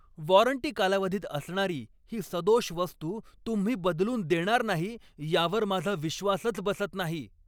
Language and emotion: Marathi, angry